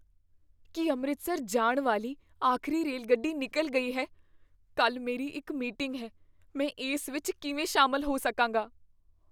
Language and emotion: Punjabi, fearful